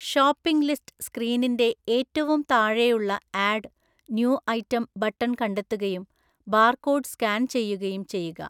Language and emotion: Malayalam, neutral